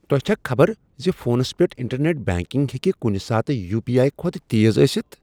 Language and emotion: Kashmiri, surprised